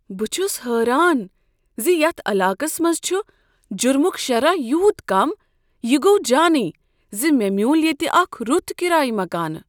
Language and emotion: Kashmiri, surprised